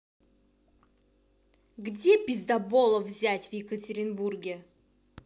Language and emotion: Russian, angry